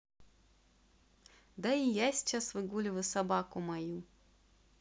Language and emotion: Russian, neutral